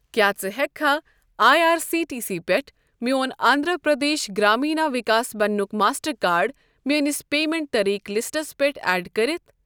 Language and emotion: Kashmiri, neutral